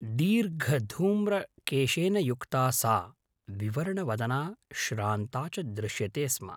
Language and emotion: Sanskrit, neutral